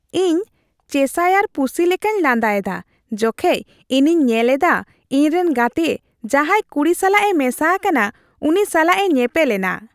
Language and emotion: Santali, happy